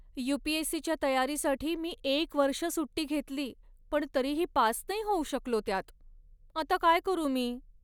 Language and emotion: Marathi, sad